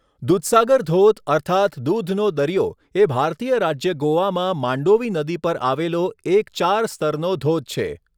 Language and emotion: Gujarati, neutral